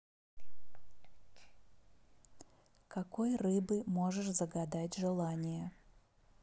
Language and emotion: Russian, neutral